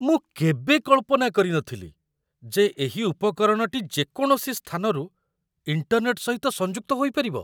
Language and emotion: Odia, surprised